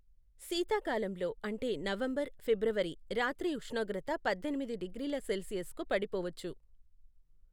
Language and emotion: Telugu, neutral